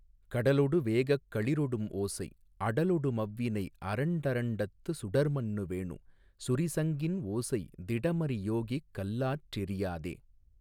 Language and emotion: Tamil, neutral